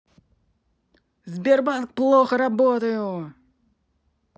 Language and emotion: Russian, angry